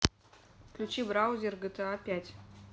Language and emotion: Russian, neutral